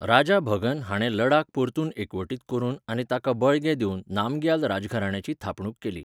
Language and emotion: Goan Konkani, neutral